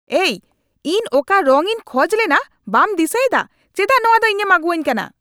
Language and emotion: Santali, angry